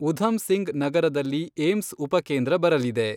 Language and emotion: Kannada, neutral